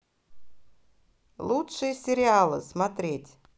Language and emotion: Russian, positive